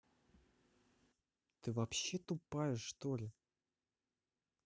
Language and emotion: Russian, neutral